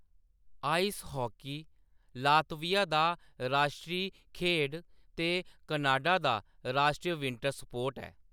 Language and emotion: Dogri, neutral